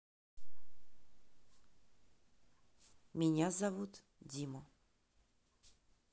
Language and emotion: Russian, neutral